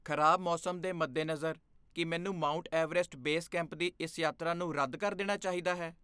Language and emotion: Punjabi, fearful